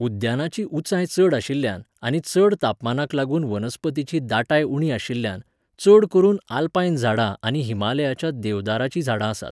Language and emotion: Goan Konkani, neutral